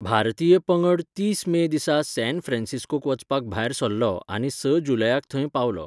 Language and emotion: Goan Konkani, neutral